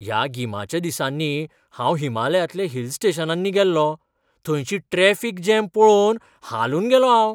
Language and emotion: Goan Konkani, surprised